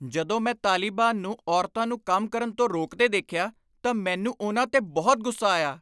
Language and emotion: Punjabi, angry